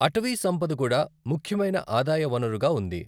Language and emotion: Telugu, neutral